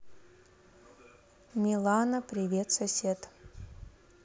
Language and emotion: Russian, neutral